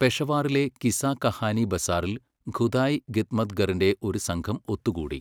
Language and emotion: Malayalam, neutral